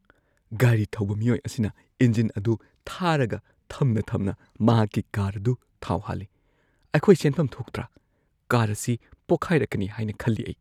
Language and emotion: Manipuri, fearful